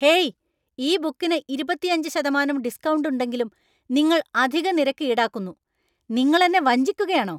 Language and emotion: Malayalam, angry